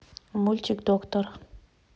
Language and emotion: Russian, neutral